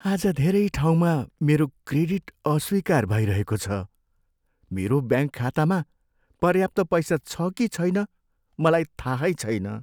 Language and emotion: Nepali, sad